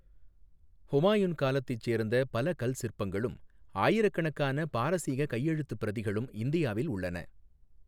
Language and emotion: Tamil, neutral